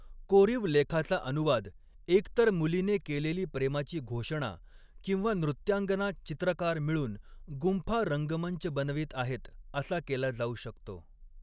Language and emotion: Marathi, neutral